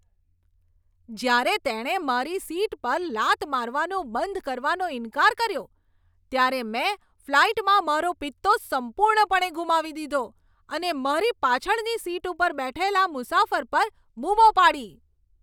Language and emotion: Gujarati, angry